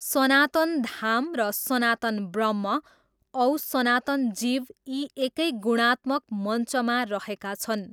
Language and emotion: Nepali, neutral